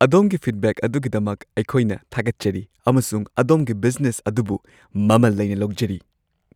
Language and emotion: Manipuri, happy